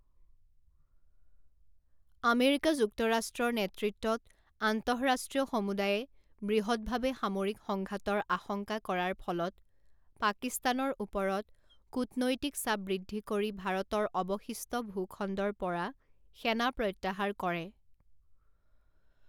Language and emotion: Assamese, neutral